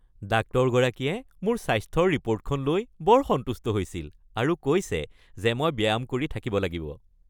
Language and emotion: Assamese, happy